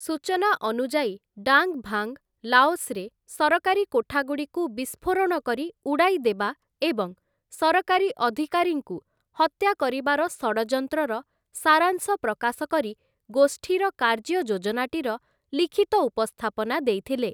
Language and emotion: Odia, neutral